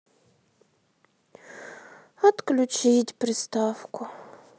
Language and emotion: Russian, sad